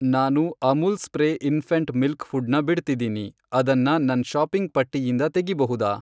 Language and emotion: Kannada, neutral